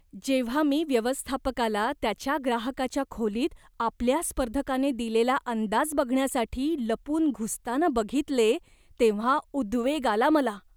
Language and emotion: Marathi, disgusted